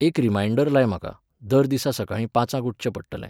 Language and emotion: Goan Konkani, neutral